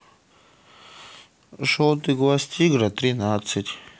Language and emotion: Russian, neutral